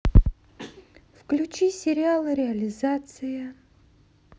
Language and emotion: Russian, neutral